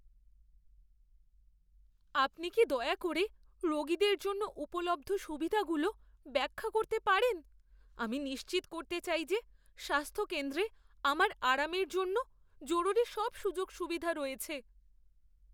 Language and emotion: Bengali, fearful